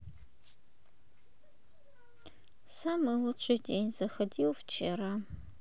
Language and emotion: Russian, sad